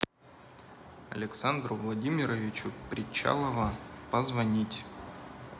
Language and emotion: Russian, neutral